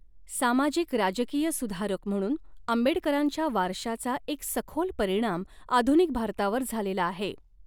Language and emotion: Marathi, neutral